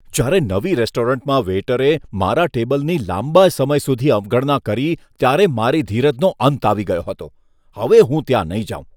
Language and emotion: Gujarati, disgusted